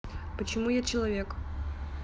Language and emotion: Russian, neutral